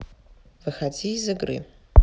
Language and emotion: Russian, neutral